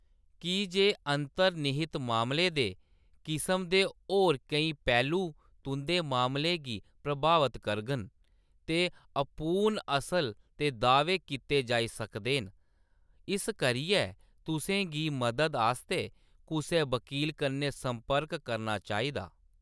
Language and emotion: Dogri, neutral